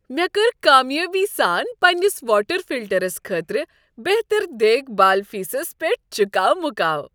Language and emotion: Kashmiri, happy